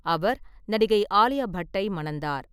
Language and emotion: Tamil, neutral